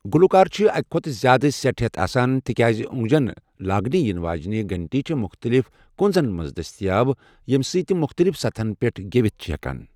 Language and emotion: Kashmiri, neutral